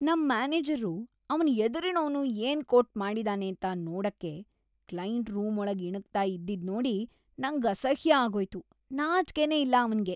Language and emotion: Kannada, disgusted